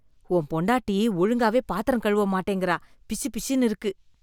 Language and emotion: Tamil, disgusted